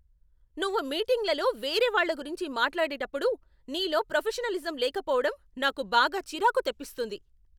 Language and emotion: Telugu, angry